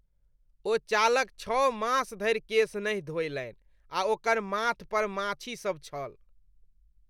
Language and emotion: Maithili, disgusted